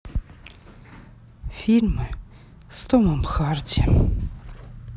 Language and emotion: Russian, sad